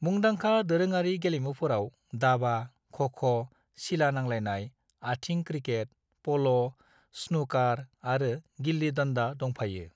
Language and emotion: Bodo, neutral